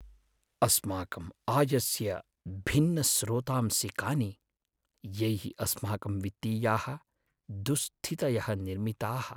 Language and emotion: Sanskrit, sad